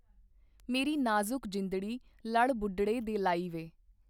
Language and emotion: Punjabi, neutral